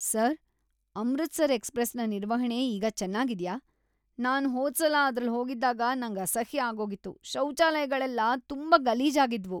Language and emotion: Kannada, disgusted